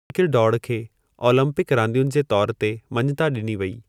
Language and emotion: Sindhi, neutral